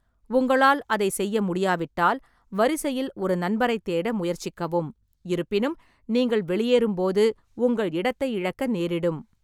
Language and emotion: Tamil, neutral